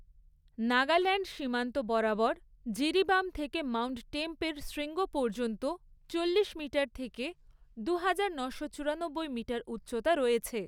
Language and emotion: Bengali, neutral